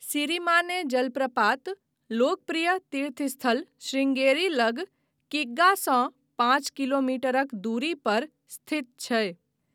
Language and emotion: Maithili, neutral